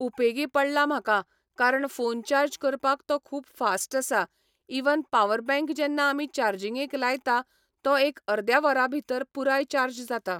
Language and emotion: Goan Konkani, neutral